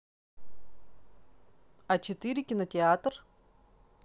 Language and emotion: Russian, neutral